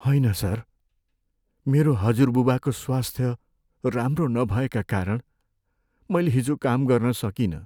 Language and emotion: Nepali, sad